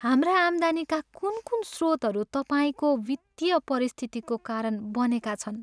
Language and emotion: Nepali, sad